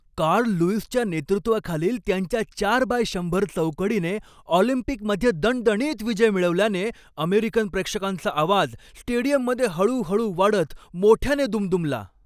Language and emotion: Marathi, happy